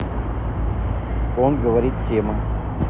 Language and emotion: Russian, neutral